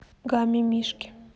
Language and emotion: Russian, neutral